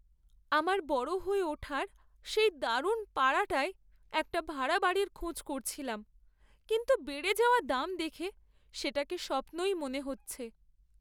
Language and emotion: Bengali, sad